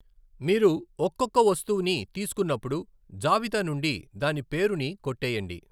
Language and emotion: Telugu, neutral